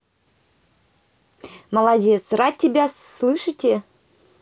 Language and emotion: Russian, positive